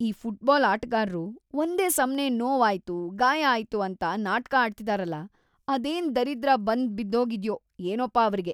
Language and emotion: Kannada, disgusted